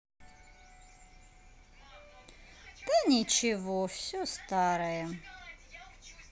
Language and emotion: Russian, sad